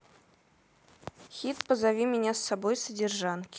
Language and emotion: Russian, neutral